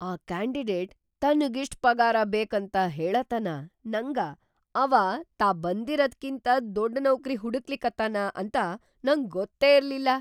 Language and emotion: Kannada, surprised